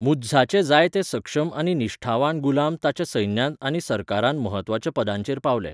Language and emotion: Goan Konkani, neutral